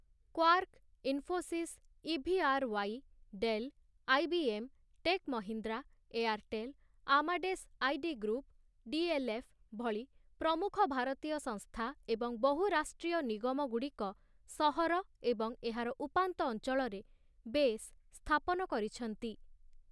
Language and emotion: Odia, neutral